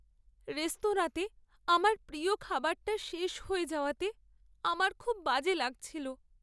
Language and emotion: Bengali, sad